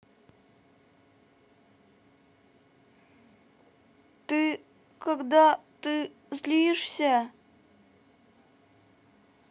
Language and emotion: Russian, sad